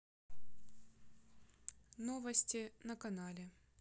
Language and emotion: Russian, neutral